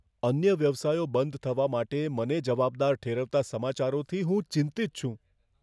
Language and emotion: Gujarati, fearful